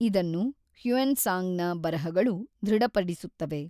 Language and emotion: Kannada, neutral